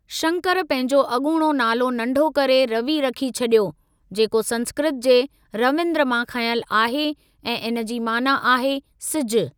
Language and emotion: Sindhi, neutral